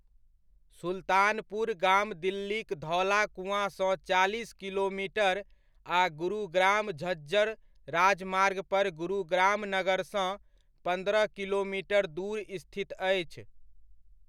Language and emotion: Maithili, neutral